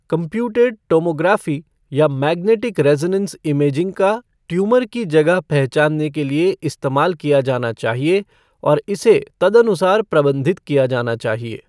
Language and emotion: Hindi, neutral